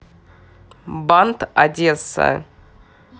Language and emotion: Russian, neutral